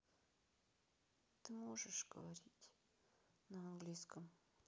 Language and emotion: Russian, sad